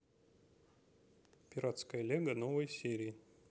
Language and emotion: Russian, neutral